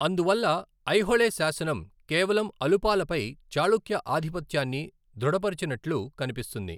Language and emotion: Telugu, neutral